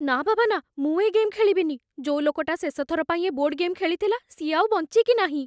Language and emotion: Odia, fearful